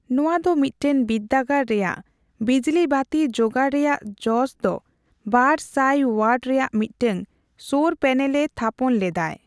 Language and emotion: Santali, neutral